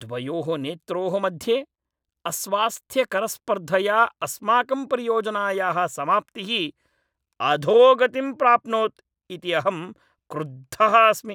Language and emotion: Sanskrit, angry